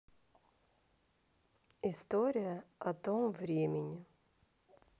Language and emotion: Russian, neutral